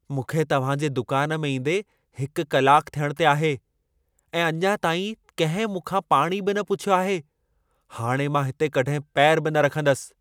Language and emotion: Sindhi, angry